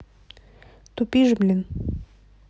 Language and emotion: Russian, neutral